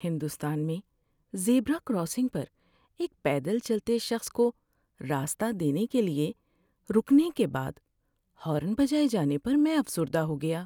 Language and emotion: Urdu, sad